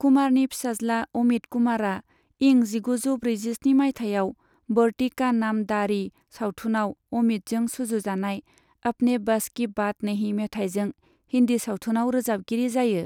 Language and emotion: Bodo, neutral